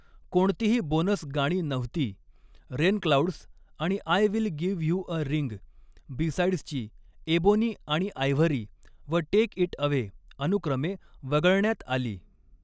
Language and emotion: Marathi, neutral